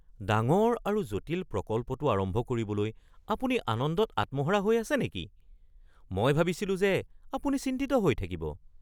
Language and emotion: Assamese, surprised